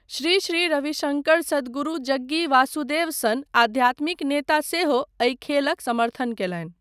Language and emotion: Maithili, neutral